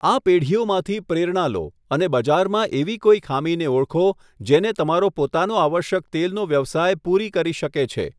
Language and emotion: Gujarati, neutral